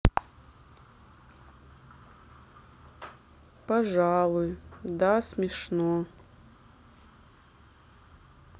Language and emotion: Russian, sad